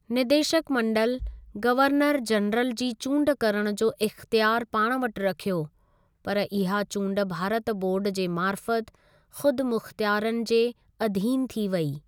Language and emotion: Sindhi, neutral